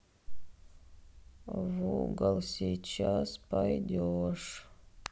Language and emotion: Russian, sad